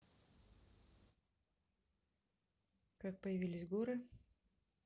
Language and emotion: Russian, neutral